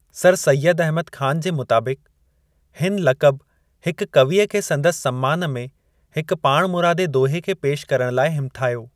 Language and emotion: Sindhi, neutral